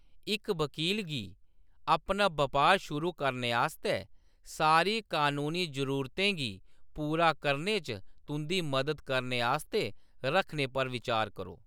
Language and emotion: Dogri, neutral